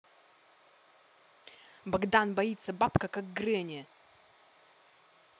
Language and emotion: Russian, angry